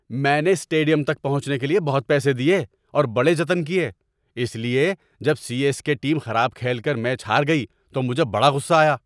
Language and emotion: Urdu, angry